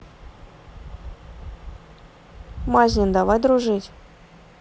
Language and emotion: Russian, neutral